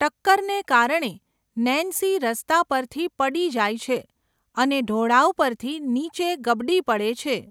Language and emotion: Gujarati, neutral